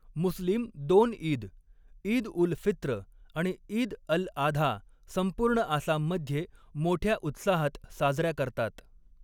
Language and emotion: Marathi, neutral